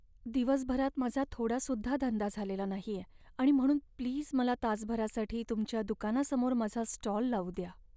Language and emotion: Marathi, sad